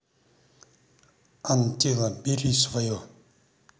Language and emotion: Russian, neutral